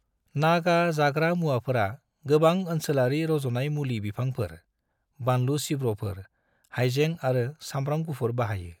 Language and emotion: Bodo, neutral